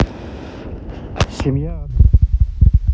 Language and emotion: Russian, neutral